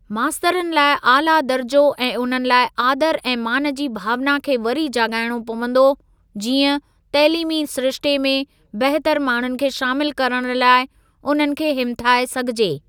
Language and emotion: Sindhi, neutral